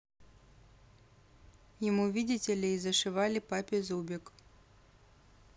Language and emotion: Russian, neutral